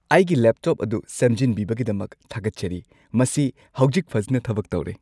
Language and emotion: Manipuri, happy